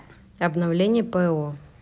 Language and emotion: Russian, neutral